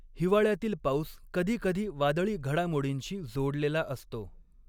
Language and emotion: Marathi, neutral